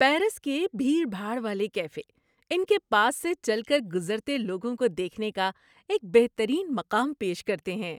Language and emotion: Urdu, happy